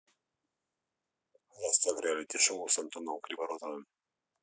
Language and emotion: Russian, neutral